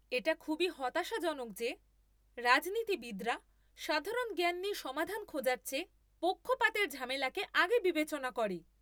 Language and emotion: Bengali, angry